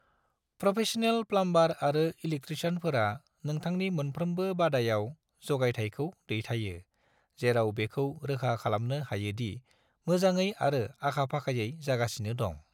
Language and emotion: Bodo, neutral